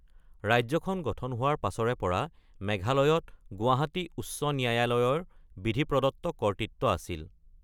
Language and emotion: Assamese, neutral